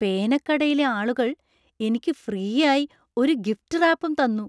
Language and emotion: Malayalam, surprised